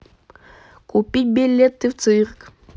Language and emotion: Russian, positive